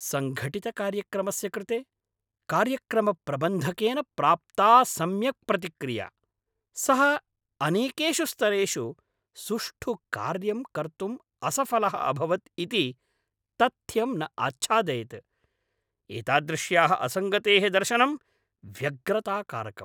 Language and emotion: Sanskrit, angry